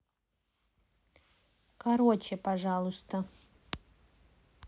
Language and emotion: Russian, neutral